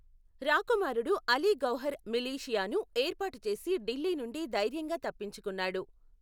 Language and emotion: Telugu, neutral